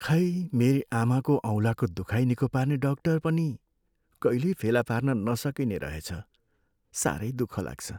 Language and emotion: Nepali, sad